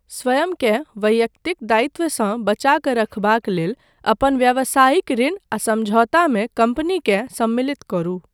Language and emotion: Maithili, neutral